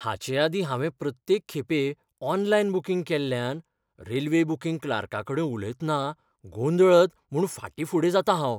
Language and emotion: Goan Konkani, fearful